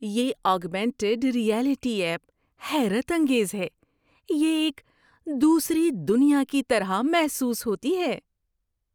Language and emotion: Urdu, surprised